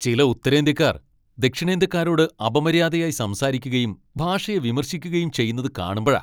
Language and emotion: Malayalam, angry